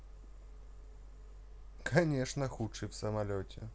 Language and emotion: Russian, neutral